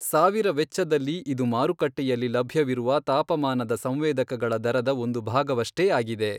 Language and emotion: Kannada, neutral